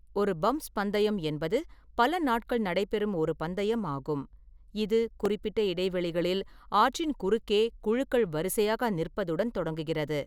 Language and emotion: Tamil, neutral